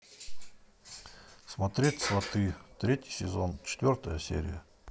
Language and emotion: Russian, neutral